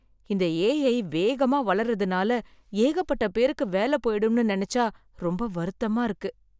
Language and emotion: Tamil, sad